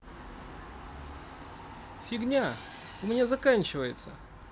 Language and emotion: Russian, neutral